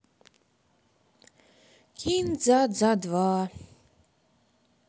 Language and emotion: Russian, sad